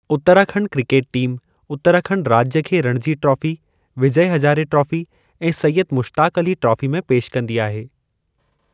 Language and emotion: Sindhi, neutral